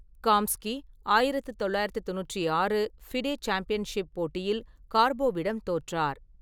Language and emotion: Tamil, neutral